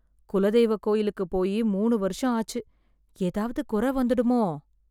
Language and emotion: Tamil, fearful